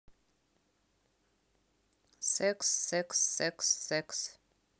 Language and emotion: Russian, neutral